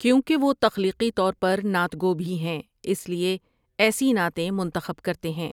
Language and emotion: Urdu, neutral